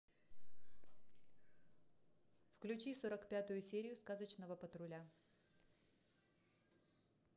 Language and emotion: Russian, neutral